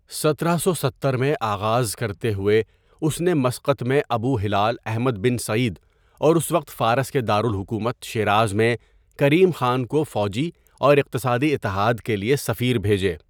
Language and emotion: Urdu, neutral